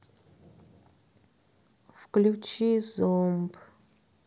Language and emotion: Russian, sad